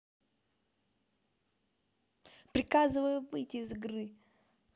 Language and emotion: Russian, angry